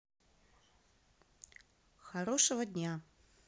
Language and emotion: Russian, neutral